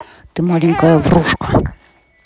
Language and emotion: Russian, angry